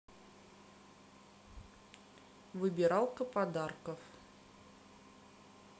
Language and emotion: Russian, neutral